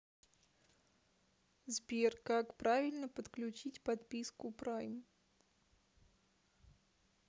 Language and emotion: Russian, neutral